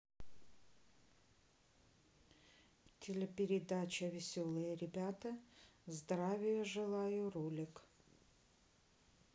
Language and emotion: Russian, neutral